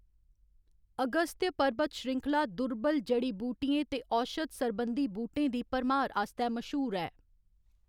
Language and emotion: Dogri, neutral